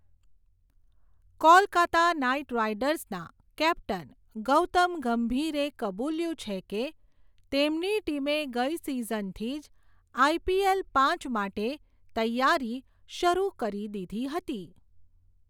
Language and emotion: Gujarati, neutral